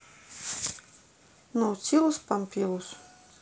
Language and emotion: Russian, neutral